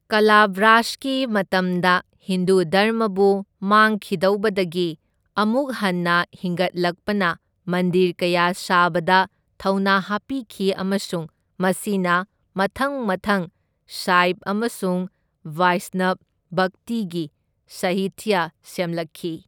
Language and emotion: Manipuri, neutral